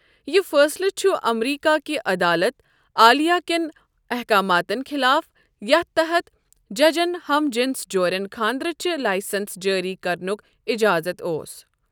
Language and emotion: Kashmiri, neutral